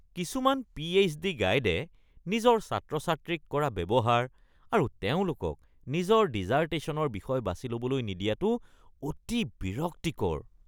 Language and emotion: Assamese, disgusted